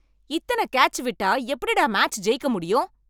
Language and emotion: Tamil, angry